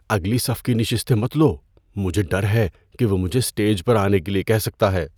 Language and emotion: Urdu, fearful